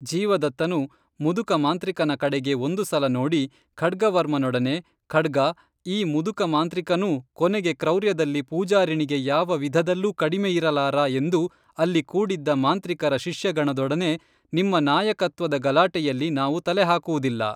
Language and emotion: Kannada, neutral